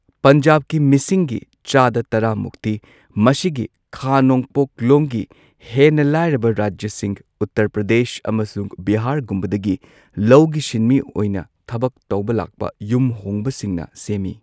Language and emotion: Manipuri, neutral